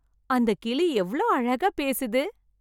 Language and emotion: Tamil, happy